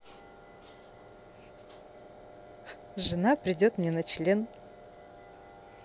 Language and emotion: Russian, positive